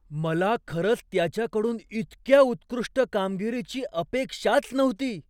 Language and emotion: Marathi, surprised